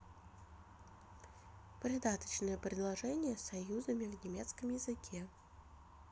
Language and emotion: Russian, neutral